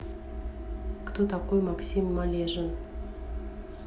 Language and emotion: Russian, neutral